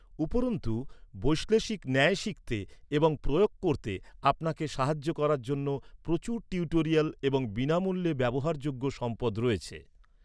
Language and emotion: Bengali, neutral